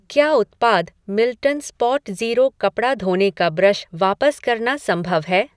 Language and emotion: Hindi, neutral